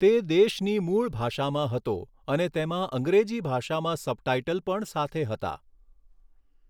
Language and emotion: Gujarati, neutral